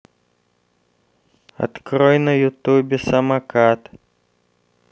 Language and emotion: Russian, neutral